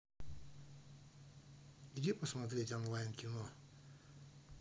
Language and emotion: Russian, neutral